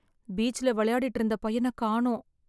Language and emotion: Tamil, sad